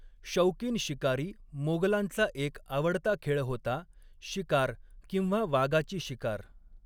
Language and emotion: Marathi, neutral